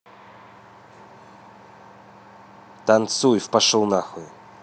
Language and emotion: Russian, angry